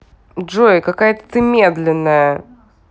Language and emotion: Russian, angry